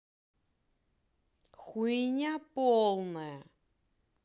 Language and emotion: Russian, angry